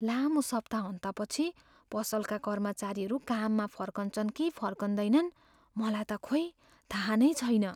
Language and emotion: Nepali, fearful